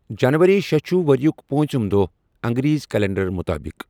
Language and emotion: Kashmiri, neutral